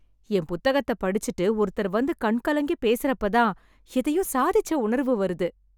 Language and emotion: Tamil, happy